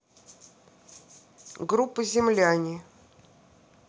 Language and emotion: Russian, neutral